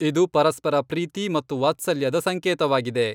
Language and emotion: Kannada, neutral